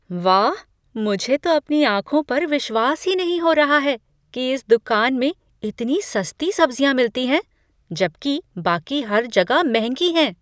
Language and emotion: Hindi, surprised